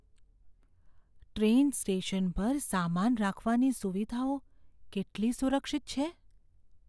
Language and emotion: Gujarati, fearful